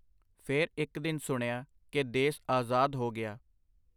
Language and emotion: Punjabi, neutral